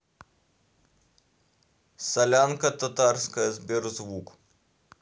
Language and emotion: Russian, neutral